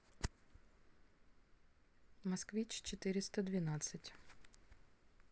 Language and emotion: Russian, neutral